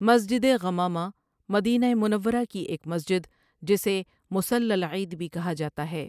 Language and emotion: Urdu, neutral